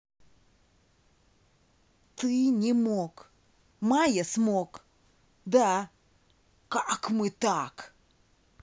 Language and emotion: Russian, angry